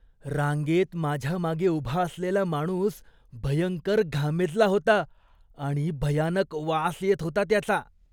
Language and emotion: Marathi, disgusted